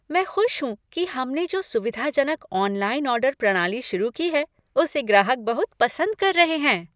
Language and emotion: Hindi, happy